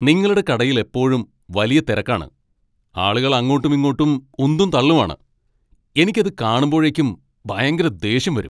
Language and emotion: Malayalam, angry